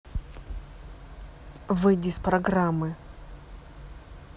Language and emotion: Russian, angry